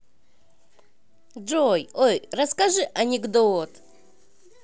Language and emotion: Russian, positive